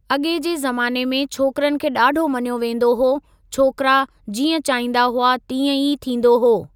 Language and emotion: Sindhi, neutral